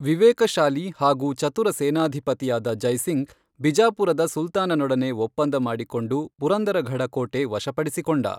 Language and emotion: Kannada, neutral